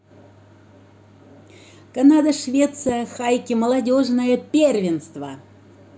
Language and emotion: Russian, positive